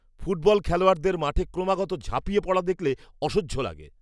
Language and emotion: Bengali, disgusted